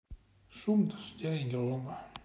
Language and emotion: Russian, sad